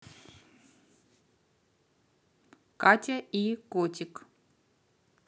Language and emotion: Russian, neutral